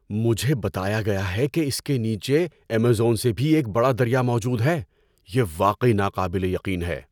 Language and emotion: Urdu, surprised